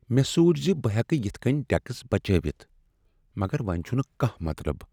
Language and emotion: Kashmiri, sad